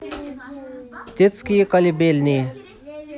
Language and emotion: Russian, neutral